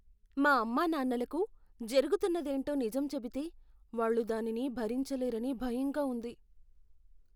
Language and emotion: Telugu, fearful